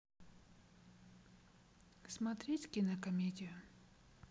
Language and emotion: Russian, neutral